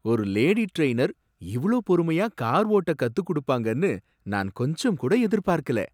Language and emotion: Tamil, surprised